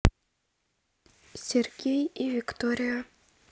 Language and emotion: Russian, neutral